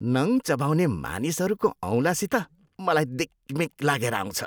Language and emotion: Nepali, disgusted